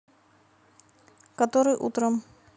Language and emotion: Russian, neutral